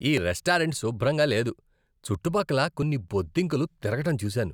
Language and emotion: Telugu, disgusted